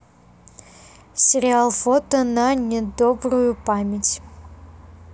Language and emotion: Russian, neutral